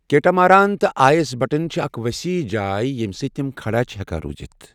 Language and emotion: Kashmiri, neutral